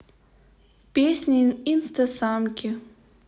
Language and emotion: Russian, neutral